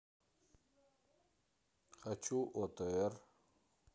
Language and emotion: Russian, neutral